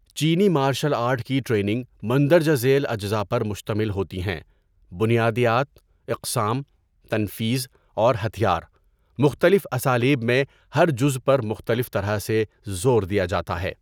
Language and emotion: Urdu, neutral